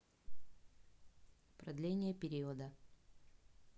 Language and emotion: Russian, neutral